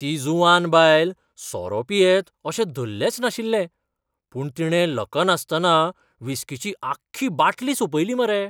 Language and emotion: Goan Konkani, surprised